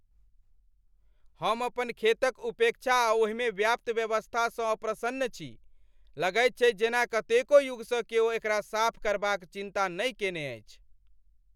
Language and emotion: Maithili, angry